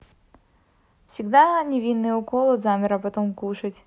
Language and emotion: Russian, neutral